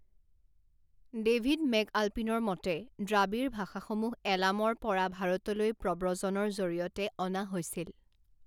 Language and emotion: Assamese, neutral